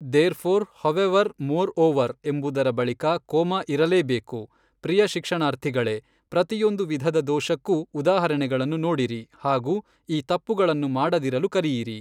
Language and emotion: Kannada, neutral